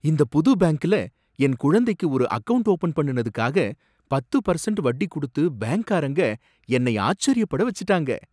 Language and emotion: Tamil, surprised